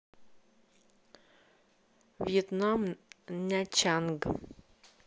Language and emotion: Russian, neutral